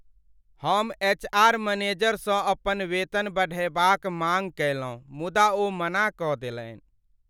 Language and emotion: Maithili, sad